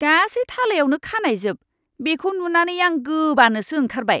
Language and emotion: Bodo, disgusted